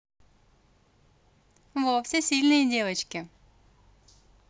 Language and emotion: Russian, positive